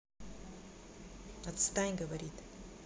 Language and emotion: Russian, angry